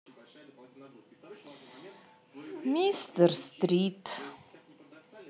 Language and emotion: Russian, sad